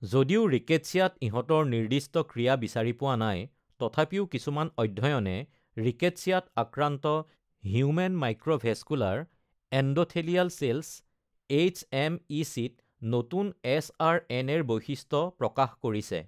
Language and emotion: Assamese, neutral